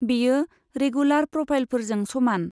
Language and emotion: Bodo, neutral